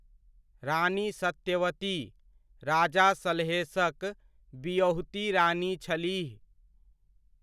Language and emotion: Maithili, neutral